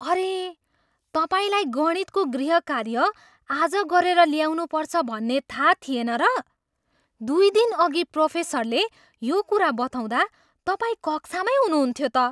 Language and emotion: Nepali, surprised